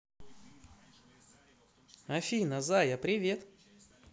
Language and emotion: Russian, positive